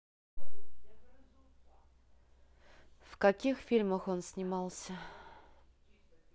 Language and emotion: Russian, neutral